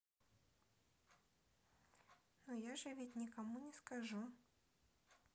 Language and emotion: Russian, neutral